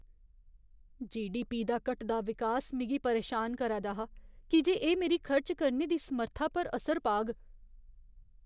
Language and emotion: Dogri, fearful